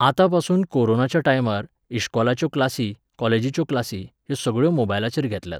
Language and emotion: Goan Konkani, neutral